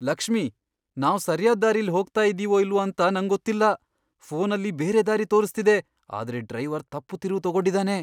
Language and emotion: Kannada, fearful